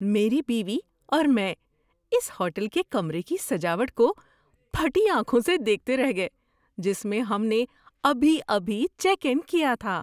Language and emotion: Urdu, surprised